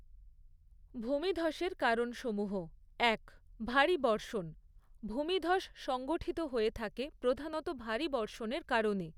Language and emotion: Bengali, neutral